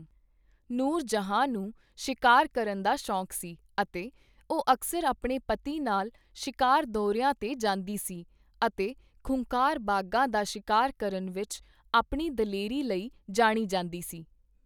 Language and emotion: Punjabi, neutral